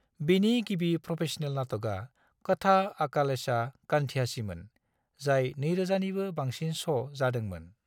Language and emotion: Bodo, neutral